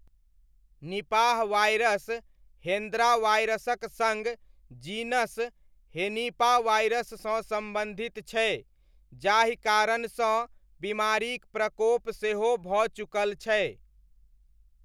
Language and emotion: Maithili, neutral